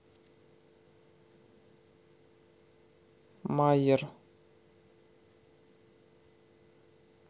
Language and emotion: Russian, neutral